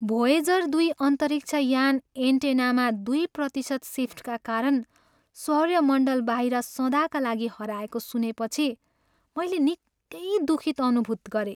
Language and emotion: Nepali, sad